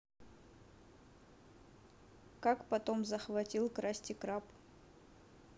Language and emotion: Russian, neutral